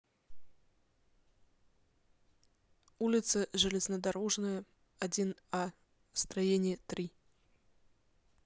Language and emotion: Russian, neutral